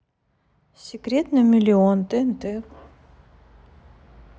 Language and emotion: Russian, neutral